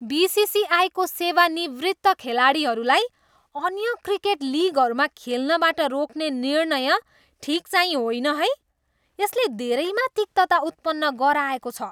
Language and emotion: Nepali, disgusted